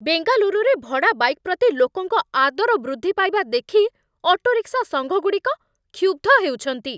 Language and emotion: Odia, angry